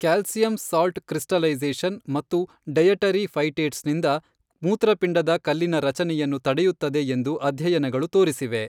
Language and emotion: Kannada, neutral